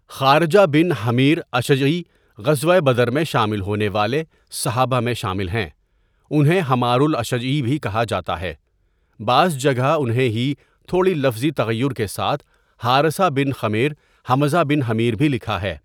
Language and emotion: Urdu, neutral